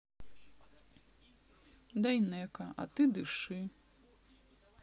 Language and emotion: Russian, neutral